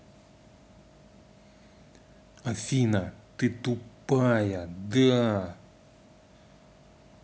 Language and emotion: Russian, angry